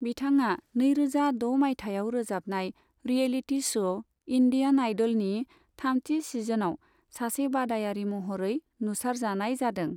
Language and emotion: Bodo, neutral